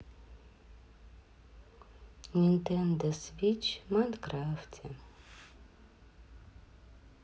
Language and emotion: Russian, sad